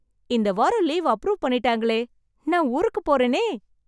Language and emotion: Tamil, happy